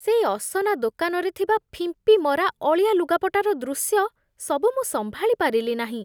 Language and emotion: Odia, disgusted